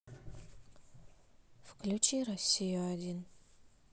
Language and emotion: Russian, sad